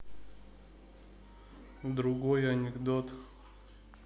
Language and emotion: Russian, neutral